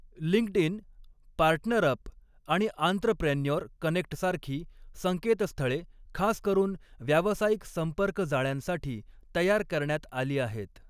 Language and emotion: Marathi, neutral